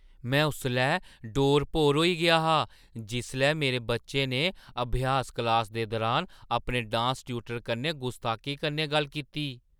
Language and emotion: Dogri, surprised